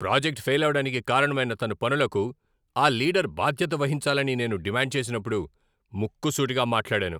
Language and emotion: Telugu, angry